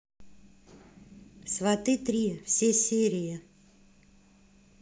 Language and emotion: Russian, neutral